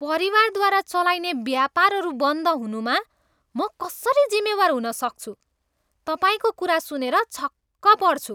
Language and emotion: Nepali, disgusted